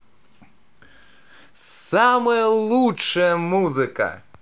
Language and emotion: Russian, positive